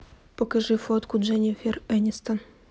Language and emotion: Russian, neutral